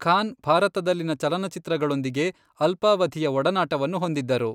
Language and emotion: Kannada, neutral